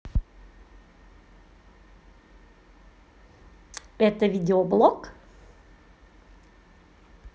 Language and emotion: Russian, positive